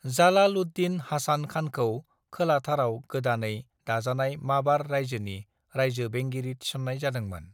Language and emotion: Bodo, neutral